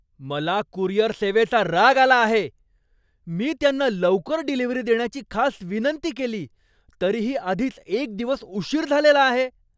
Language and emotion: Marathi, angry